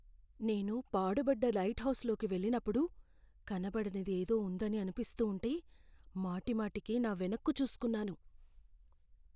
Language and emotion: Telugu, fearful